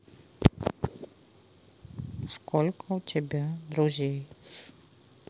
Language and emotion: Russian, sad